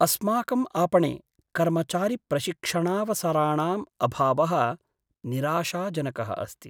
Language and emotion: Sanskrit, sad